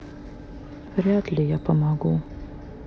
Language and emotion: Russian, sad